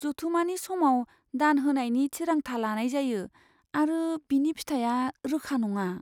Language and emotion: Bodo, fearful